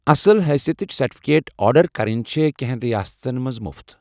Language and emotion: Kashmiri, neutral